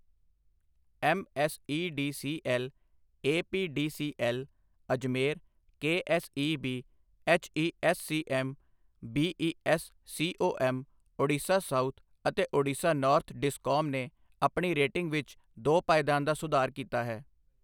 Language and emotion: Punjabi, neutral